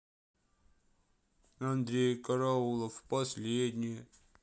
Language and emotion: Russian, sad